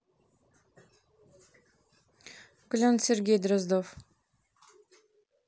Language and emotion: Russian, neutral